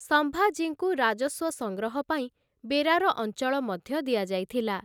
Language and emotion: Odia, neutral